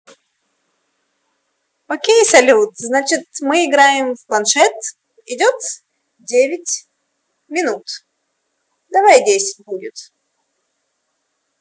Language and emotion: Russian, positive